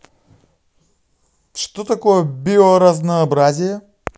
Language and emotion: Russian, positive